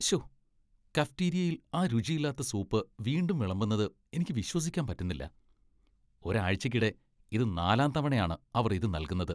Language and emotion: Malayalam, disgusted